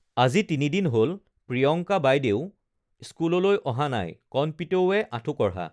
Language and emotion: Assamese, neutral